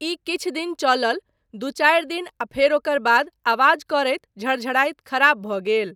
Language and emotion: Maithili, neutral